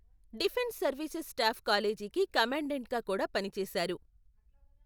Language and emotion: Telugu, neutral